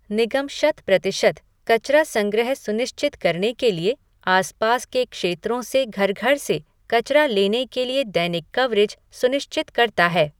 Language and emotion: Hindi, neutral